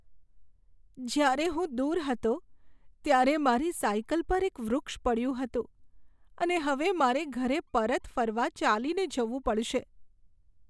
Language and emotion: Gujarati, sad